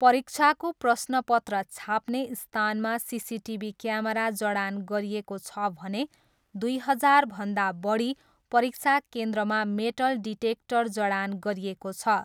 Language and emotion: Nepali, neutral